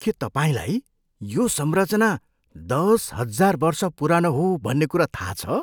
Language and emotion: Nepali, surprised